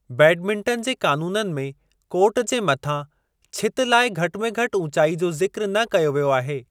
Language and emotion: Sindhi, neutral